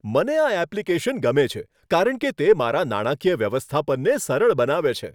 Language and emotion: Gujarati, happy